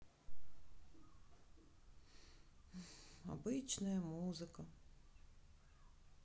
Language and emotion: Russian, sad